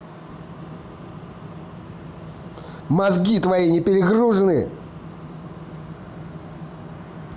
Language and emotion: Russian, angry